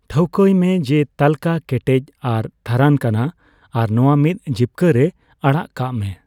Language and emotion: Santali, neutral